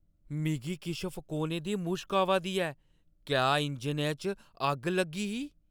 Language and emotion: Dogri, fearful